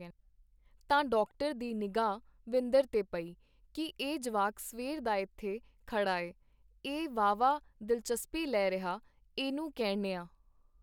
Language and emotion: Punjabi, neutral